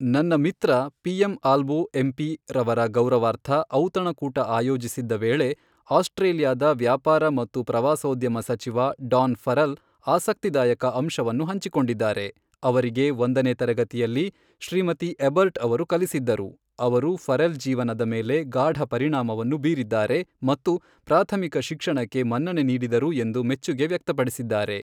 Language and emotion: Kannada, neutral